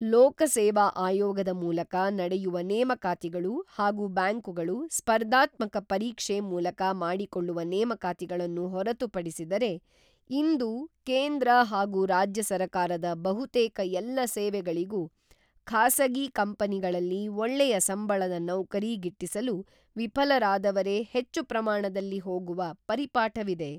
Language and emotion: Kannada, neutral